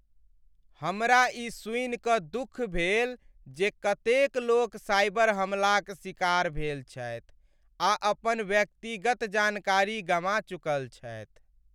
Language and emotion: Maithili, sad